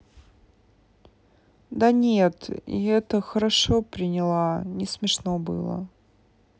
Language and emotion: Russian, sad